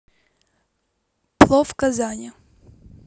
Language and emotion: Russian, neutral